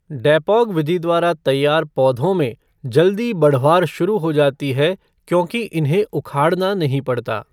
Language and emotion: Hindi, neutral